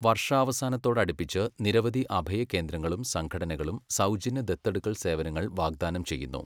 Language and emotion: Malayalam, neutral